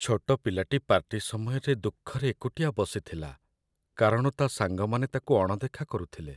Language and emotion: Odia, sad